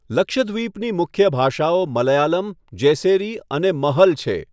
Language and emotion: Gujarati, neutral